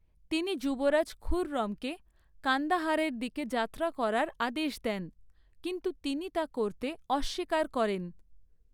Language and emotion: Bengali, neutral